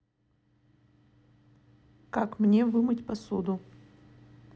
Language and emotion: Russian, neutral